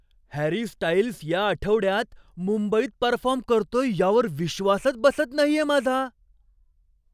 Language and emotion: Marathi, surprised